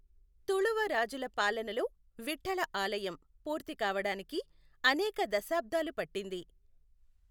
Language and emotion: Telugu, neutral